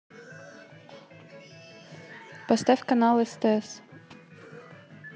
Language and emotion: Russian, neutral